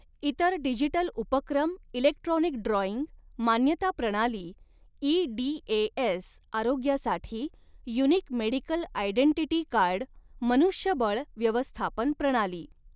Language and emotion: Marathi, neutral